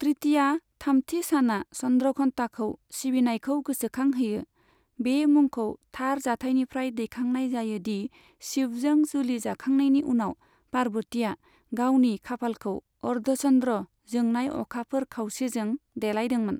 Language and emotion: Bodo, neutral